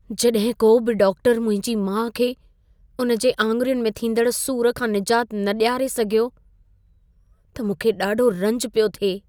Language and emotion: Sindhi, sad